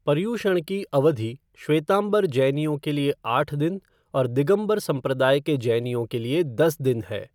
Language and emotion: Hindi, neutral